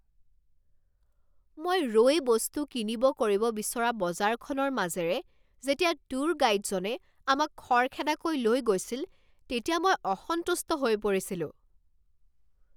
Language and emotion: Assamese, angry